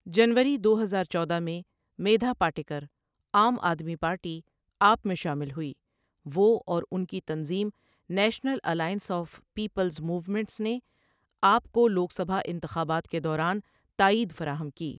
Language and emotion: Urdu, neutral